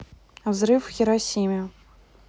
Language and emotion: Russian, neutral